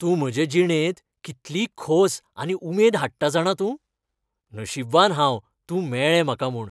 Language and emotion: Goan Konkani, happy